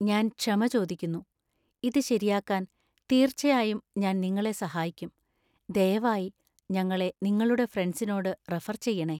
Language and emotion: Malayalam, fearful